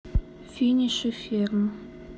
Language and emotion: Russian, sad